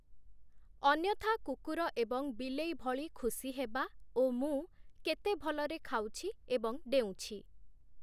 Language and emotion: Odia, neutral